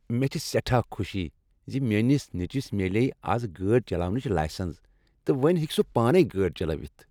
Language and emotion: Kashmiri, happy